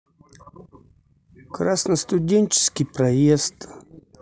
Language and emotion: Russian, neutral